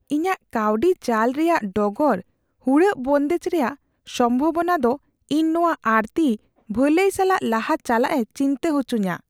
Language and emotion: Santali, fearful